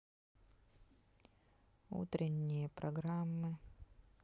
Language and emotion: Russian, sad